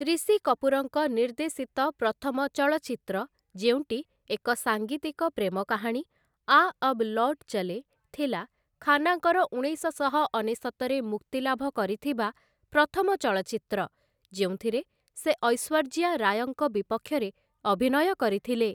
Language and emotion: Odia, neutral